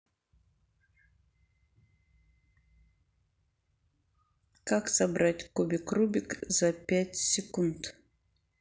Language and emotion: Russian, neutral